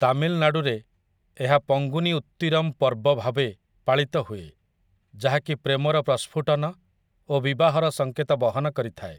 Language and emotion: Odia, neutral